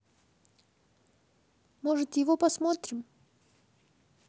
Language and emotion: Russian, neutral